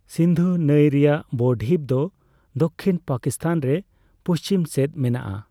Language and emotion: Santali, neutral